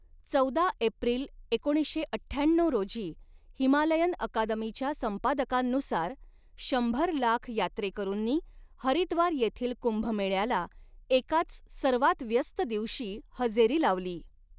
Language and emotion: Marathi, neutral